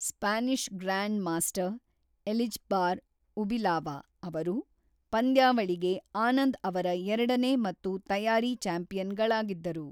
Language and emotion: Kannada, neutral